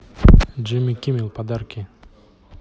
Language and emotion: Russian, neutral